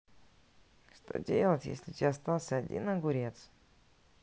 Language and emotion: Russian, neutral